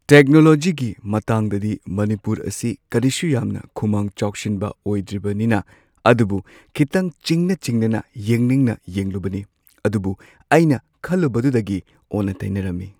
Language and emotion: Manipuri, neutral